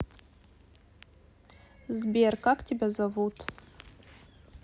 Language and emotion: Russian, neutral